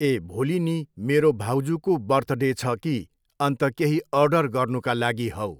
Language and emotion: Nepali, neutral